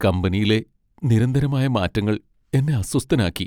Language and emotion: Malayalam, sad